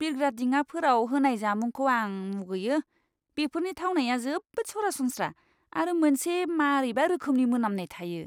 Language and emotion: Bodo, disgusted